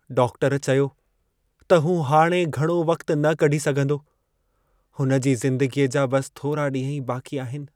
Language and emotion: Sindhi, sad